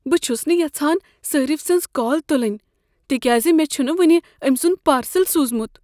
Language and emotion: Kashmiri, fearful